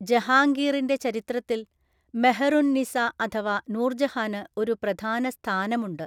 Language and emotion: Malayalam, neutral